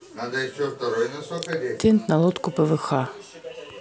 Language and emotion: Russian, neutral